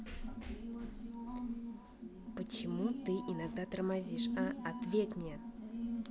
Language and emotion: Russian, angry